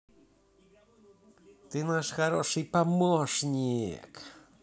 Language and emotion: Russian, positive